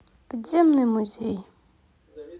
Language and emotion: Russian, neutral